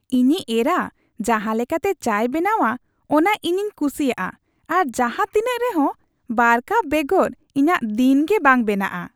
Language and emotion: Santali, happy